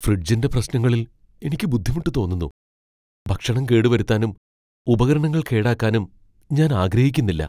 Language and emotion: Malayalam, fearful